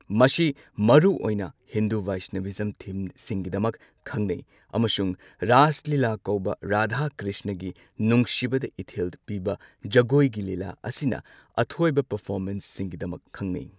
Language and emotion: Manipuri, neutral